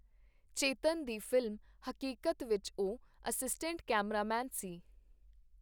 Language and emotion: Punjabi, neutral